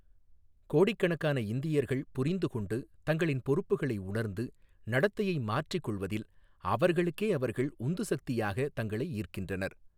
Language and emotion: Tamil, neutral